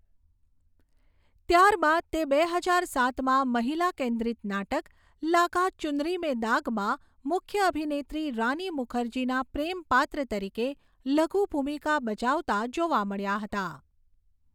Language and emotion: Gujarati, neutral